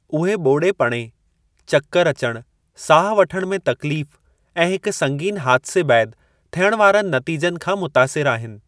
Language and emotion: Sindhi, neutral